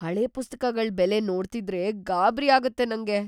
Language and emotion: Kannada, fearful